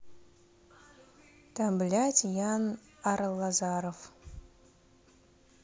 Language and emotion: Russian, neutral